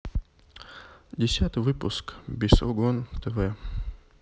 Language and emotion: Russian, sad